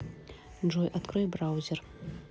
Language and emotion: Russian, neutral